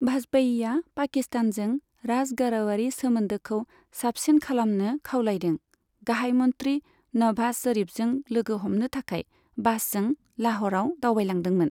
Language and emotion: Bodo, neutral